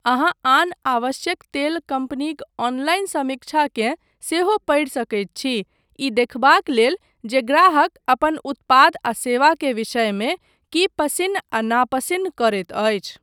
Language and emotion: Maithili, neutral